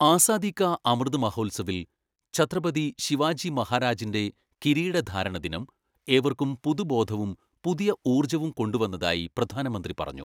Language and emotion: Malayalam, neutral